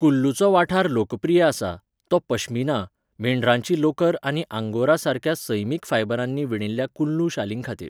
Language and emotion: Goan Konkani, neutral